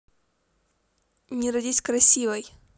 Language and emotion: Russian, positive